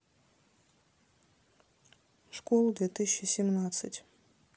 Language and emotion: Russian, neutral